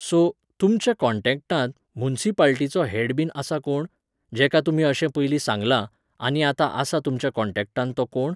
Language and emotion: Goan Konkani, neutral